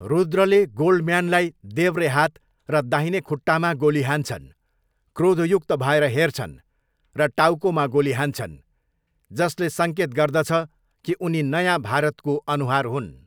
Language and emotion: Nepali, neutral